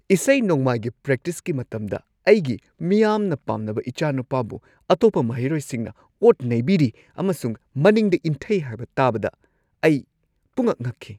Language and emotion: Manipuri, surprised